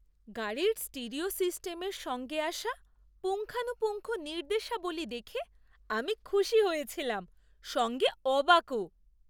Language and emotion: Bengali, surprised